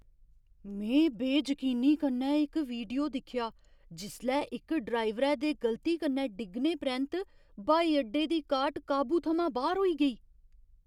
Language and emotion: Dogri, surprised